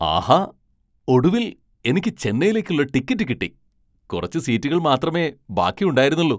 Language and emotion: Malayalam, surprised